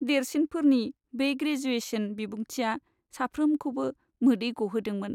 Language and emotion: Bodo, sad